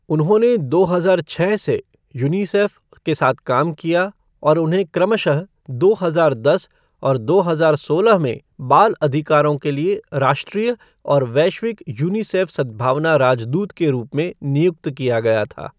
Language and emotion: Hindi, neutral